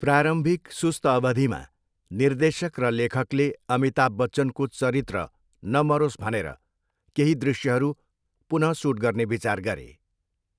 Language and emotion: Nepali, neutral